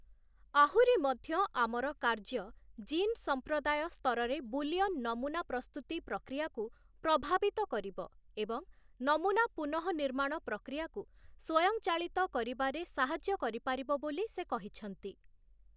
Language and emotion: Odia, neutral